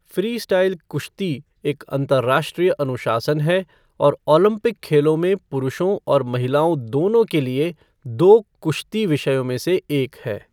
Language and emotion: Hindi, neutral